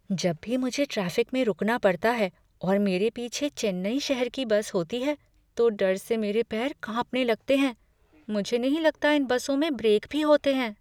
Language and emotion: Hindi, fearful